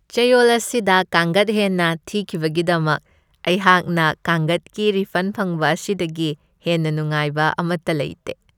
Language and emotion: Manipuri, happy